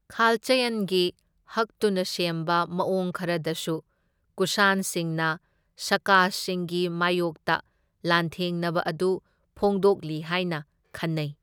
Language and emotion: Manipuri, neutral